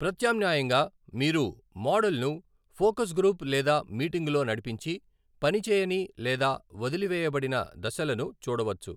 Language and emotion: Telugu, neutral